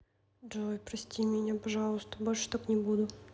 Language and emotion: Russian, sad